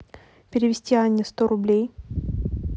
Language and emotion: Russian, neutral